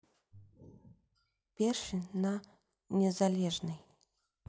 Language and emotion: Russian, neutral